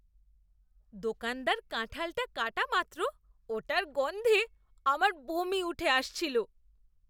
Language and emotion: Bengali, disgusted